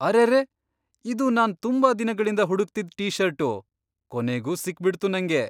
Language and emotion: Kannada, surprised